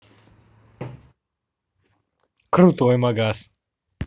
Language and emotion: Russian, positive